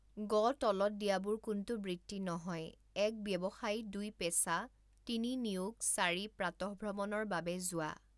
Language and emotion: Assamese, neutral